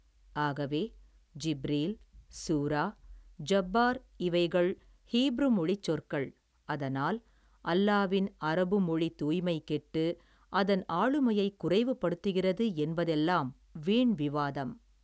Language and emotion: Tamil, neutral